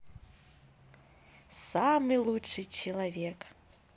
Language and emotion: Russian, positive